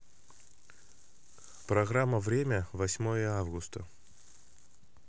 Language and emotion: Russian, neutral